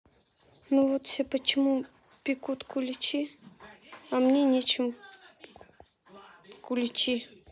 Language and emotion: Russian, sad